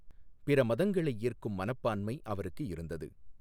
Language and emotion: Tamil, neutral